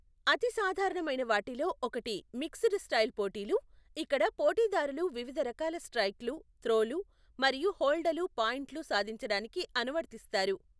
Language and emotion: Telugu, neutral